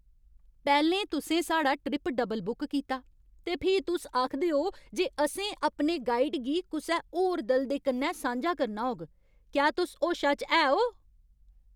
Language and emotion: Dogri, angry